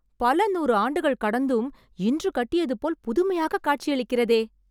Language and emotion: Tamil, surprised